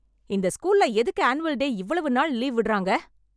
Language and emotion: Tamil, angry